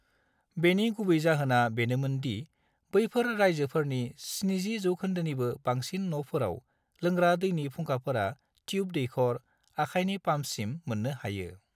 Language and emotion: Bodo, neutral